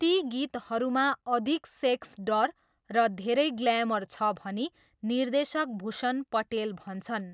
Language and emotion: Nepali, neutral